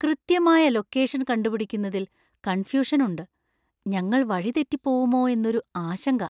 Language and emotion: Malayalam, fearful